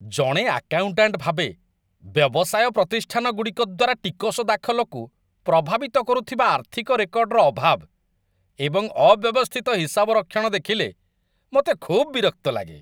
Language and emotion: Odia, disgusted